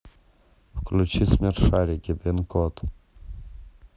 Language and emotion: Russian, neutral